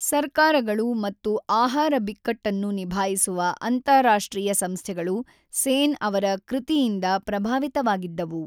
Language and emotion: Kannada, neutral